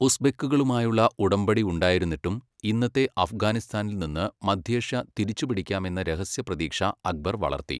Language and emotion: Malayalam, neutral